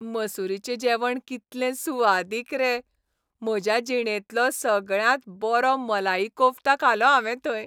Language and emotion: Goan Konkani, happy